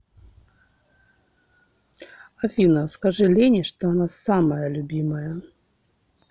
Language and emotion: Russian, neutral